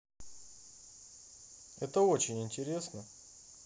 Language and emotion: Russian, positive